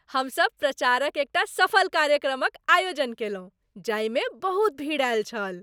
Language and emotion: Maithili, happy